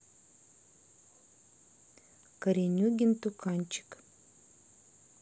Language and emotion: Russian, neutral